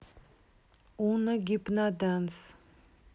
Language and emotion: Russian, neutral